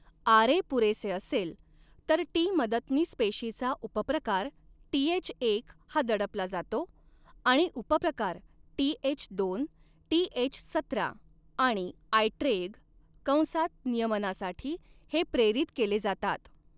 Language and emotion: Marathi, neutral